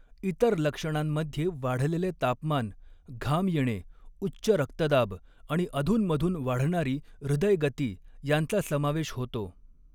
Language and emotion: Marathi, neutral